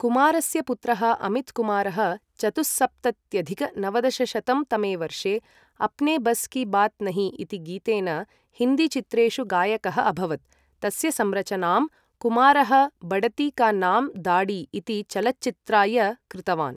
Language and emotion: Sanskrit, neutral